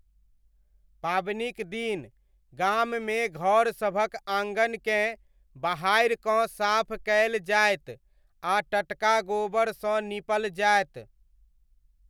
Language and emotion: Maithili, neutral